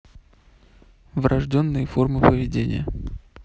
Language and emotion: Russian, neutral